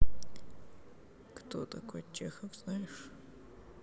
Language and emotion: Russian, sad